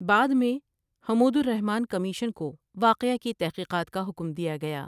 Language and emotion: Urdu, neutral